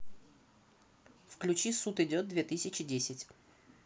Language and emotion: Russian, neutral